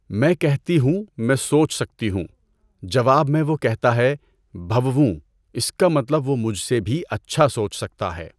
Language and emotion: Urdu, neutral